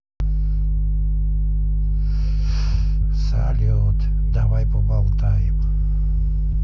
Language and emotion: Russian, sad